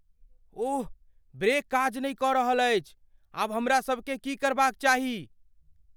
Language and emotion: Maithili, fearful